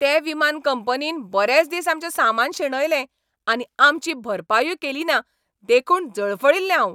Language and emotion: Goan Konkani, angry